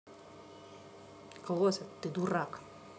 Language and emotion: Russian, angry